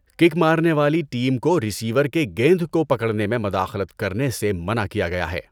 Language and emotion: Urdu, neutral